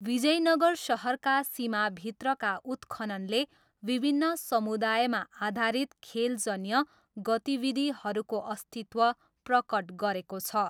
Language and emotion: Nepali, neutral